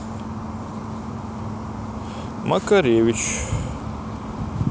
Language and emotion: Russian, neutral